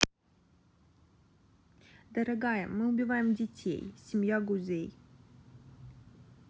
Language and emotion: Russian, neutral